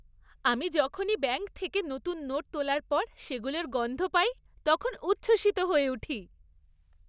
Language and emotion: Bengali, happy